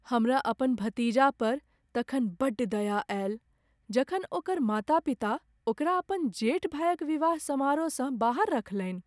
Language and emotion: Maithili, sad